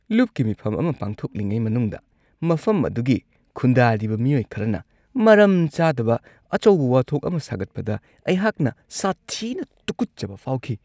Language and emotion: Manipuri, disgusted